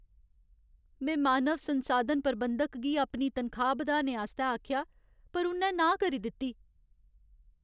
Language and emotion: Dogri, sad